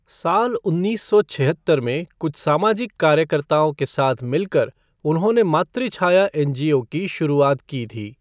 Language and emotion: Hindi, neutral